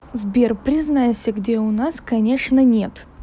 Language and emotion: Russian, neutral